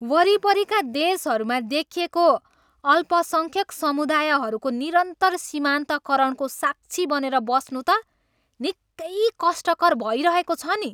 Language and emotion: Nepali, angry